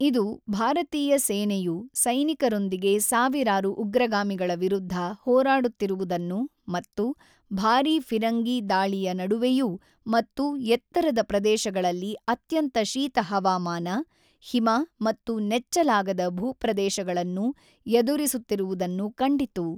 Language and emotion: Kannada, neutral